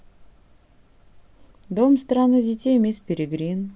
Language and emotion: Russian, neutral